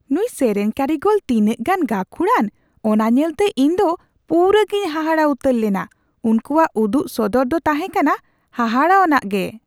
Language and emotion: Santali, surprised